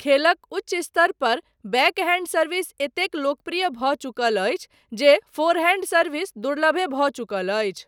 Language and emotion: Maithili, neutral